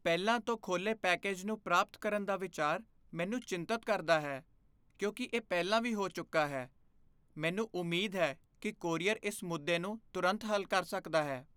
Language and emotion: Punjabi, fearful